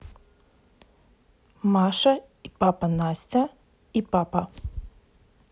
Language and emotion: Russian, neutral